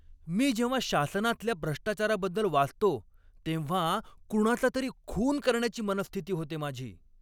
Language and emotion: Marathi, angry